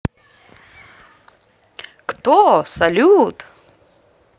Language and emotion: Russian, positive